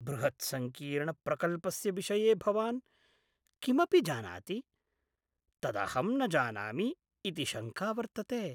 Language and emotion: Sanskrit, fearful